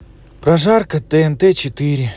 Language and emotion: Russian, neutral